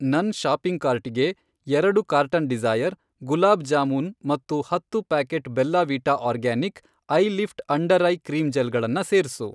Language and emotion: Kannada, neutral